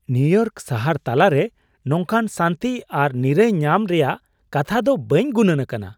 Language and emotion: Santali, surprised